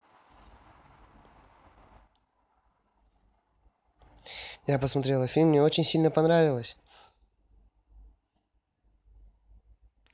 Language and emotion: Russian, positive